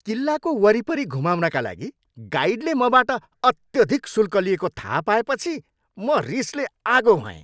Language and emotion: Nepali, angry